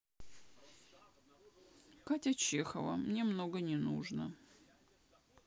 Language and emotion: Russian, sad